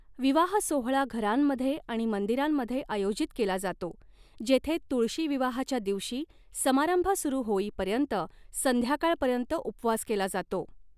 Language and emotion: Marathi, neutral